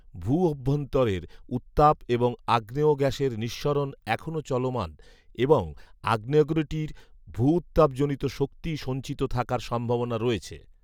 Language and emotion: Bengali, neutral